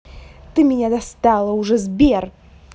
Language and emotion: Russian, angry